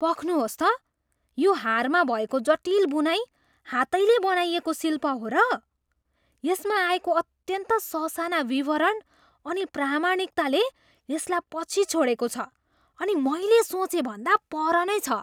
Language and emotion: Nepali, surprised